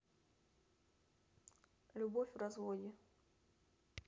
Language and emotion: Russian, neutral